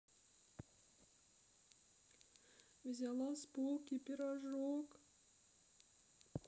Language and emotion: Russian, sad